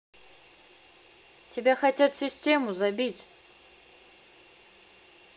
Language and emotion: Russian, neutral